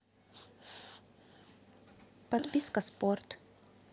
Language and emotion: Russian, neutral